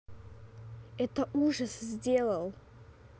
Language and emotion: Russian, neutral